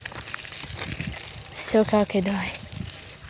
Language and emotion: Russian, neutral